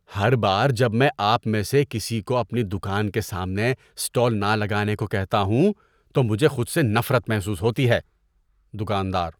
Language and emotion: Urdu, disgusted